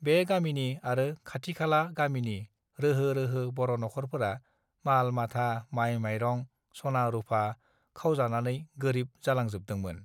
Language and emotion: Bodo, neutral